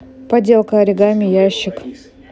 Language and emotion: Russian, neutral